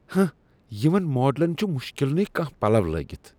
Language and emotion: Kashmiri, disgusted